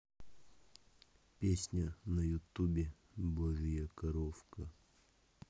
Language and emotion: Russian, neutral